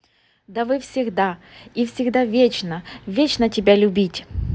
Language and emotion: Russian, neutral